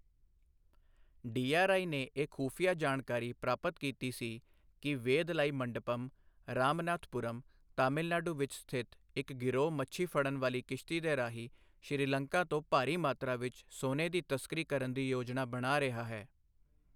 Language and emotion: Punjabi, neutral